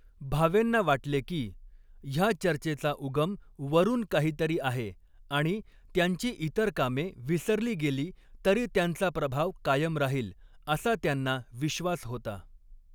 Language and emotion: Marathi, neutral